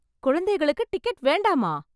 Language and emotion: Tamil, surprised